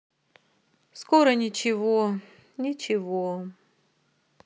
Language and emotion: Russian, sad